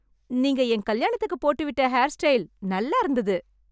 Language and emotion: Tamil, happy